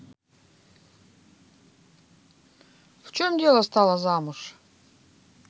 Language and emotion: Russian, neutral